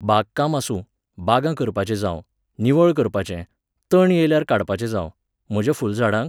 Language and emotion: Goan Konkani, neutral